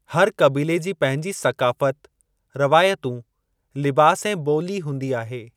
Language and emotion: Sindhi, neutral